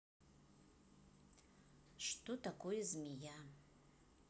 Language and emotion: Russian, neutral